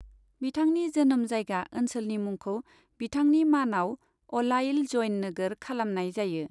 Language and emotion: Bodo, neutral